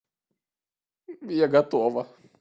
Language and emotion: Russian, positive